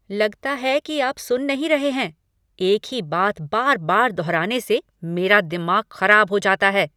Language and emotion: Hindi, angry